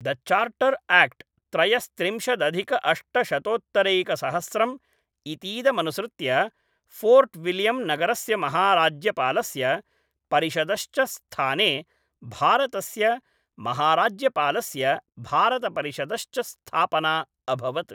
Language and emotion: Sanskrit, neutral